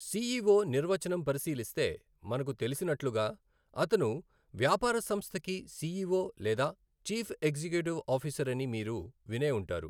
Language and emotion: Telugu, neutral